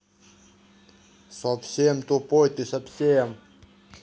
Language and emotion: Russian, angry